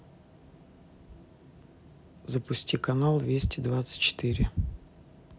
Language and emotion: Russian, neutral